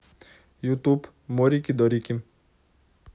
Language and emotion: Russian, neutral